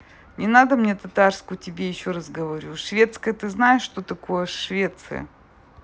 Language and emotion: Russian, neutral